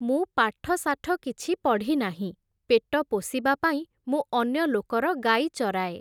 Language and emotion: Odia, neutral